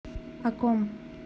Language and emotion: Russian, neutral